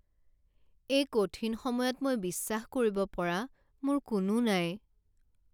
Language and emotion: Assamese, sad